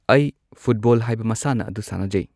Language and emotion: Manipuri, neutral